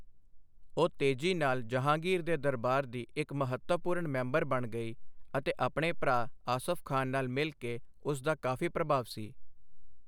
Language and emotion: Punjabi, neutral